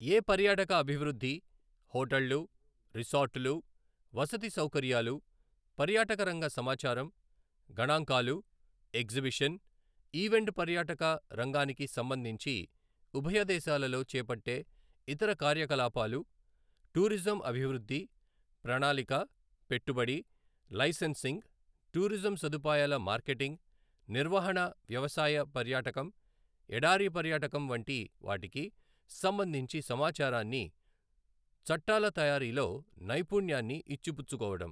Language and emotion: Telugu, neutral